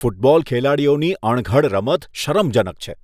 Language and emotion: Gujarati, disgusted